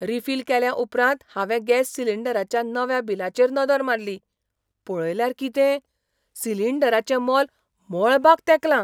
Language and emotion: Goan Konkani, surprised